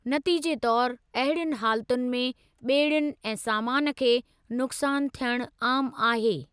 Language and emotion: Sindhi, neutral